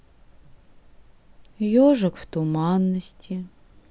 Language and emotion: Russian, sad